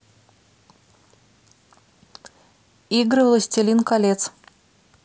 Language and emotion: Russian, neutral